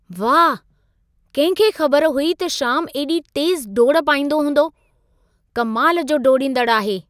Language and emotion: Sindhi, surprised